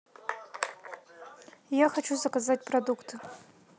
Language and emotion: Russian, neutral